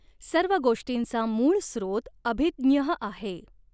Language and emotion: Marathi, neutral